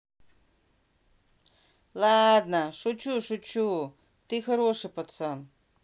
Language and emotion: Russian, neutral